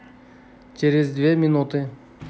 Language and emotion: Russian, neutral